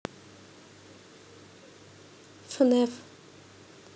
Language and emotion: Russian, neutral